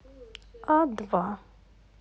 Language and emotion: Russian, neutral